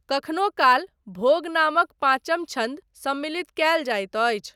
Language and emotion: Maithili, neutral